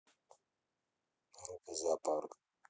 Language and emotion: Russian, neutral